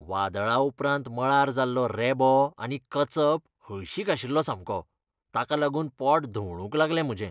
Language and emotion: Goan Konkani, disgusted